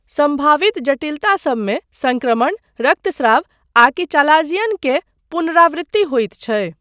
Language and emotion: Maithili, neutral